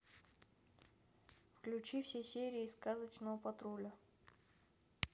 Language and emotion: Russian, neutral